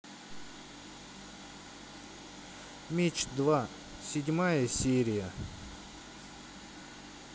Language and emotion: Russian, neutral